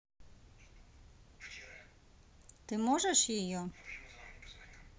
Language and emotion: Russian, neutral